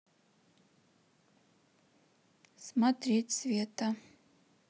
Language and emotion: Russian, neutral